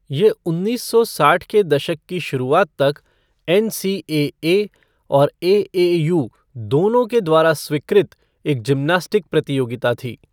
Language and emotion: Hindi, neutral